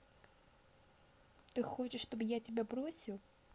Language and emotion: Russian, neutral